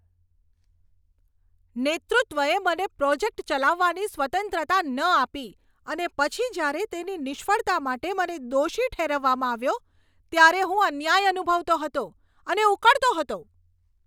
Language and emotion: Gujarati, angry